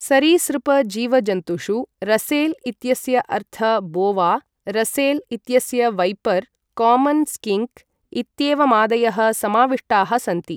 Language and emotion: Sanskrit, neutral